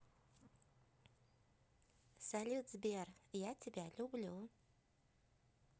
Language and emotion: Russian, positive